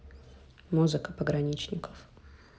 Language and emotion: Russian, neutral